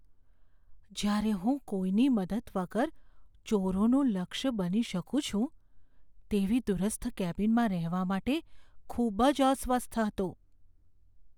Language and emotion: Gujarati, fearful